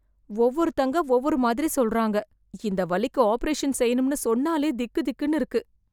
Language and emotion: Tamil, fearful